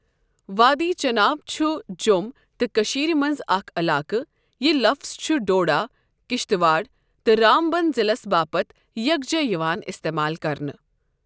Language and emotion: Kashmiri, neutral